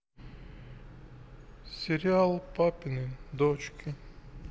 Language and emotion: Russian, sad